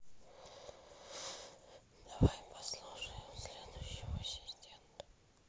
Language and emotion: Russian, neutral